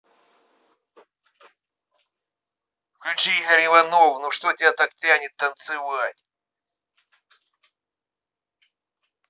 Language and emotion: Russian, neutral